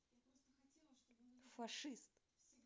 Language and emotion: Russian, angry